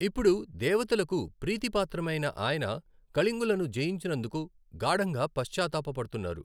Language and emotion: Telugu, neutral